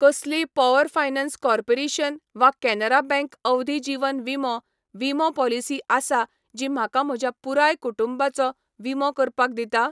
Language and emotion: Goan Konkani, neutral